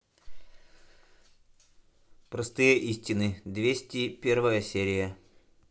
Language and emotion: Russian, neutral